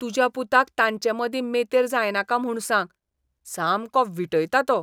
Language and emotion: Goan Konkani, disgusted